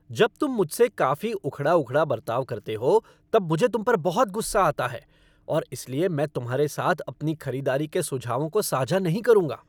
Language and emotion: Hindi, angry